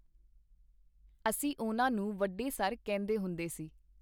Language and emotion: Punjabi, neutral